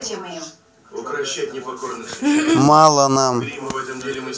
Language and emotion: Russian, neutral